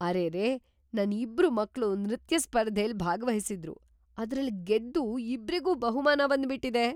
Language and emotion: Kannada, surprised